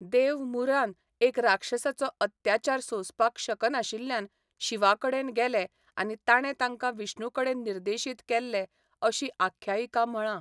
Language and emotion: Goan Konkani, neutral